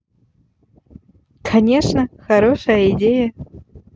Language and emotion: Russian, positive